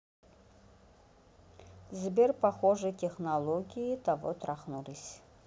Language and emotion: Russian, neutral